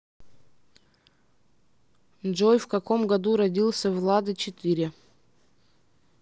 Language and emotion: Russian, neutral